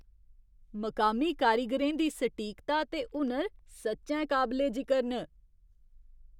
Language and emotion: Dogri, surprised